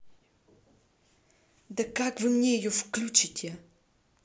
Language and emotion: Russian, angry